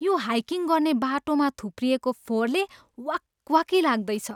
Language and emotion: Nepali, disgusted